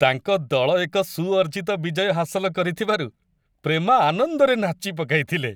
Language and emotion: Odia, happy